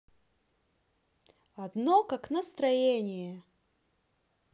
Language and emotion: Russian, positive